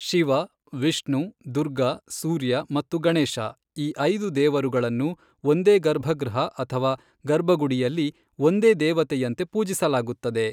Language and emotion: Kannada, neutral